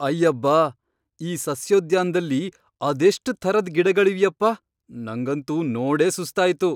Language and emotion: Kannada, surprised